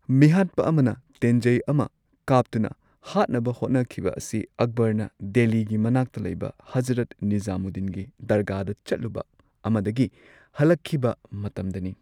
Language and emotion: Manipuri, neutral